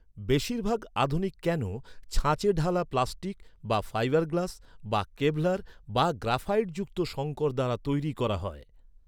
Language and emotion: Bengali, neutral